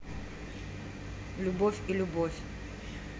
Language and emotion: Russian, neutral